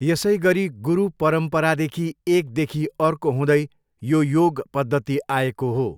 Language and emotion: Nepali, neutral